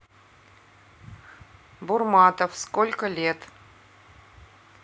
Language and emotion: Russian, neutral